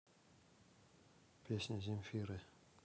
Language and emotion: Russian, neutral